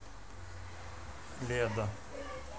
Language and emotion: Russian, neutral